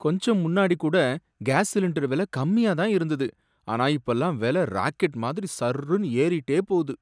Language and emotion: Tamil, sad